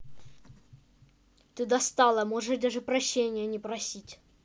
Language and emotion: Russian, angry